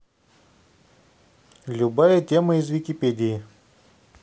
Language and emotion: Russian, neutral